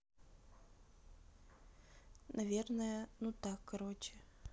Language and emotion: Russian, neutral